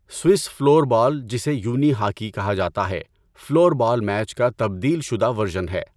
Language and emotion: Urdu, neutral